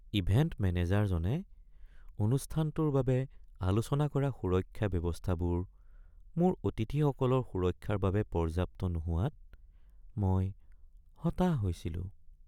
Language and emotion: Assamese, sad